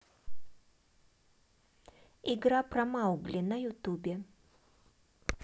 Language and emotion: Russian, neutral